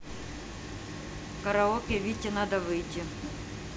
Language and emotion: Russian, neutral